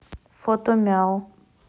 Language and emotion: Russian, neutral